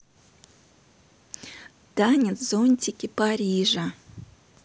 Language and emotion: Russian, neutral